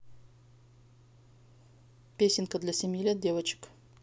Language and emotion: Russian, neutral